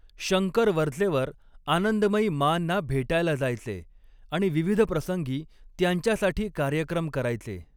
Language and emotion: Marathi, neutral